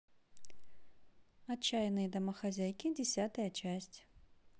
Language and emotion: Russian, neutral